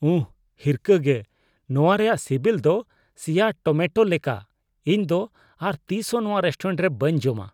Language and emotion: Santali, disgusted